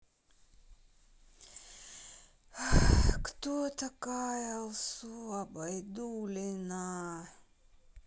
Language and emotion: Russian, sad